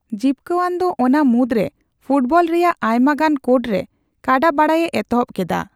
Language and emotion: Santali, neutral